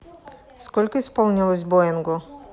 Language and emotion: Russian, neutral